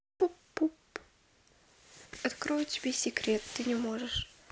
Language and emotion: Russian, neutral